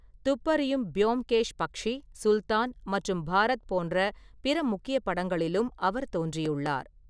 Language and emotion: Tamil, neutral